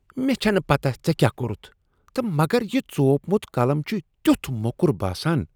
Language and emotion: Kashmiri, disgusted